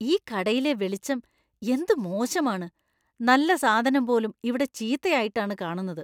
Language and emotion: Malayalam, disgusted